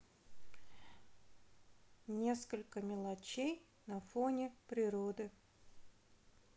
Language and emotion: Russian, neutral